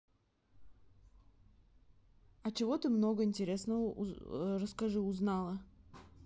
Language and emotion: Russian, neutral